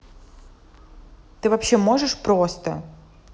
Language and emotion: Russian, angry